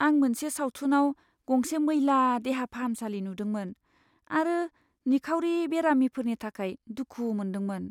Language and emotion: Bodo, sad